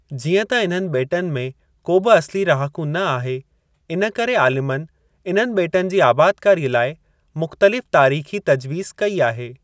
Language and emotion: Sindhi, neutral